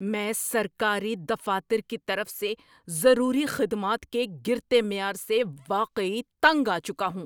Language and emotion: Urdu, angry